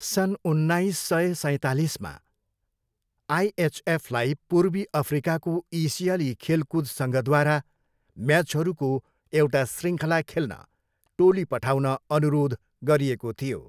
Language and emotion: Nepali, neutral